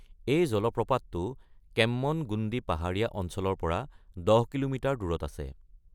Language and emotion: Assamese, neutral